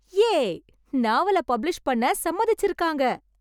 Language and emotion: Tamil, happy